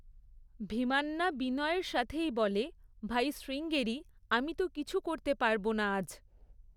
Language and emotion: Bengali, neutral